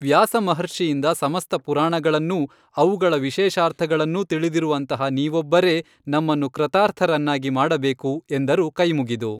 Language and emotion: Kannada, neutral